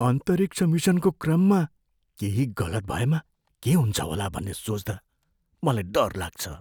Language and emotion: Nepali, fearful